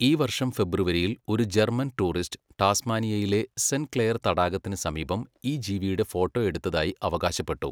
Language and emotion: Malayalam, neutral